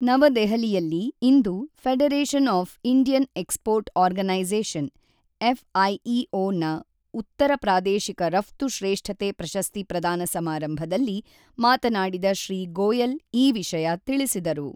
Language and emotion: Kannada, neutral